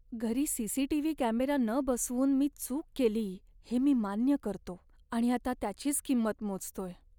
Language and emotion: Marathi, sad